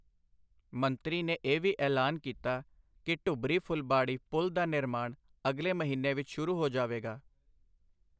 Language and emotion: Punjabi, neutral